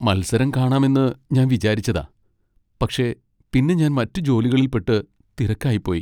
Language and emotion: Malayalam, sad